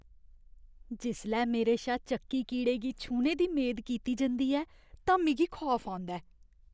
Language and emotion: Dogri, disgusted